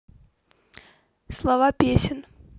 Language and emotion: Russian, neutral